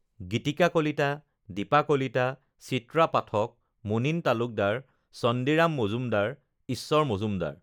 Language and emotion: Assamese, neutral